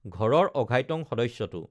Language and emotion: Assamese, neutral